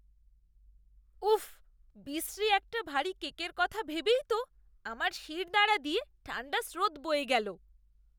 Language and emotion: Bengali, disgusted